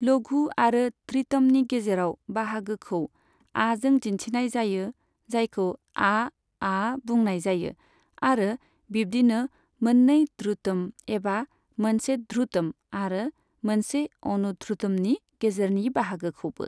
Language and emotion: Bodo, neutral